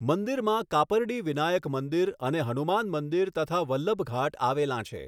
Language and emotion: Gujarati, neutral